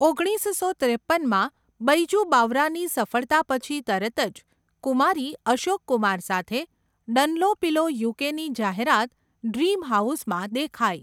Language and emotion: Gujarati, neutral